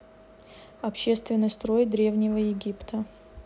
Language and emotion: Russian, neutral